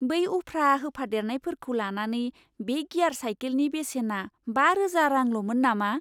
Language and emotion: Bodo, surprised